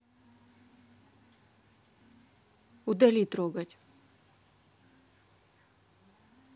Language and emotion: Russian, neutral